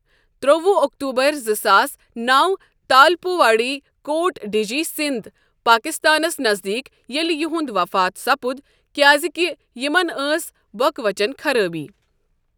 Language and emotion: Kashmiri, neutral